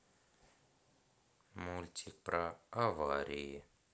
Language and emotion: Russian, neutral